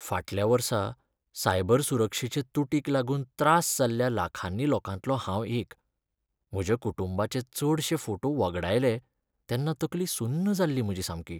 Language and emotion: Goan Konkani, sad